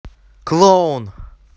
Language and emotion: Russian, angry